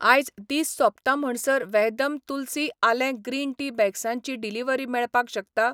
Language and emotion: Goan Konkani, neutral